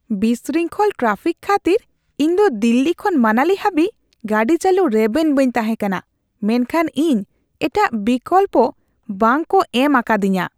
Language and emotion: Santali, disgusted